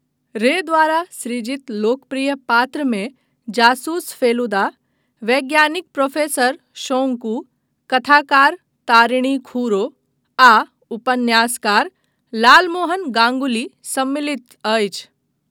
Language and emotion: Maithili, neutral